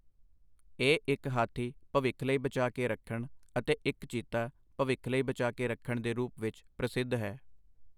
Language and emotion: Punjabi, neutral